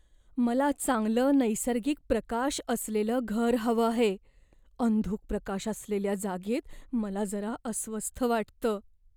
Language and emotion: Marathi, fearful